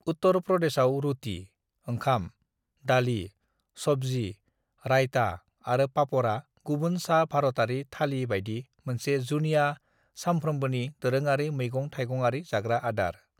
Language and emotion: Bodo, neutral